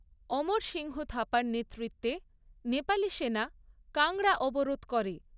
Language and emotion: Bengali, neutral